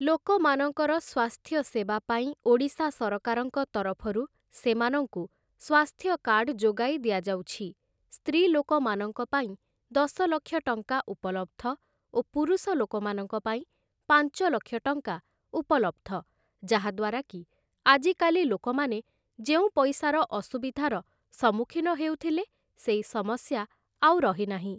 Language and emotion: Odia, neutral